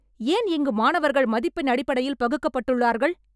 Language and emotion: Tamil, angry